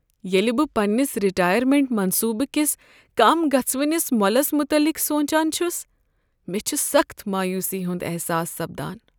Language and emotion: Kashmiri, sad